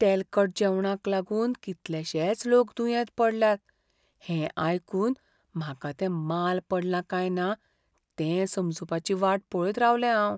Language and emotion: Goan Konkani, fearful